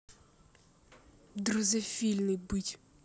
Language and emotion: Russian, angry